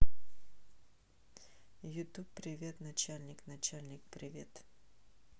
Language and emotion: Russian, neutral